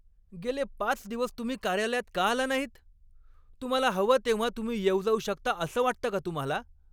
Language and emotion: Marathi, angry